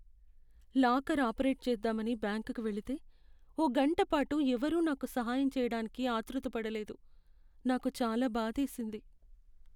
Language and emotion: Telugu, sad